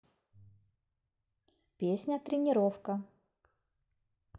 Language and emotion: Russian, neutral